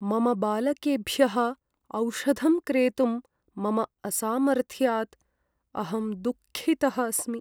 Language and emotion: Sanskrit, sad